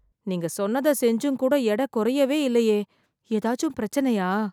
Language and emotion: Tamil, fearful